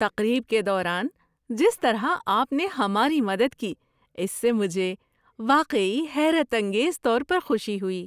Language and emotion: Urdu, surprised